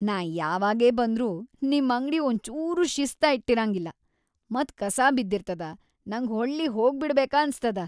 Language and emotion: Kannada, disgusted